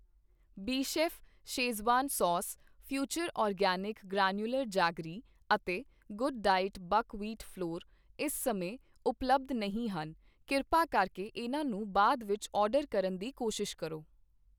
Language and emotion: Punjabi, neutral